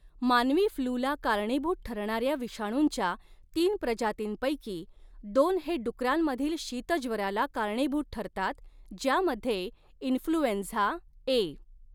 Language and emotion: Marathi, neutral